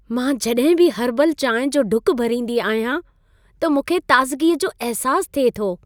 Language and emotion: Sindhi, happy